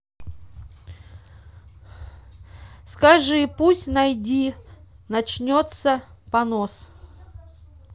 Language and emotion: Russian, neutral